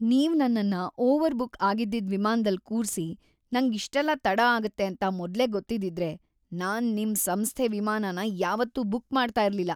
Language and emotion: Kannada, disgusted